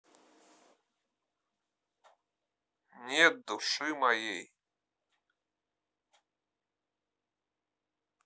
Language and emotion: Russian, neutral